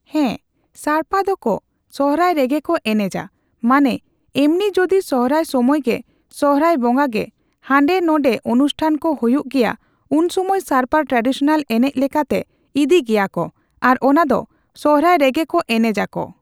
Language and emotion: Santali, neutral